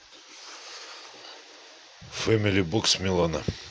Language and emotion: Russian, neutral